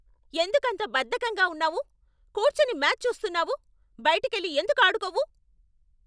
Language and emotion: Telugu, angry